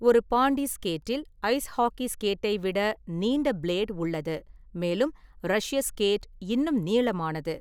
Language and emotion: Tamil, neutral